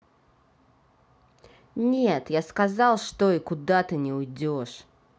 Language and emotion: Russian, angry